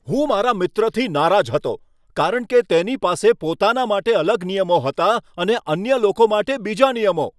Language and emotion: Gujarati, angry